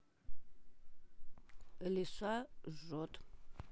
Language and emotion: Russian, neutral